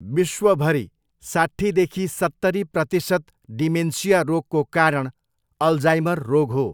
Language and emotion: Nepali, neutral